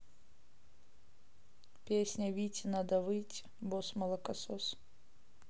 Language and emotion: Russian, neutral